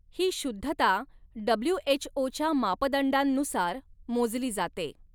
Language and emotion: Marathi, neutral